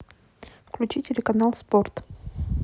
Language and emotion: Russian, neutral